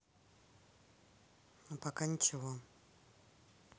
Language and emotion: Russian, neutral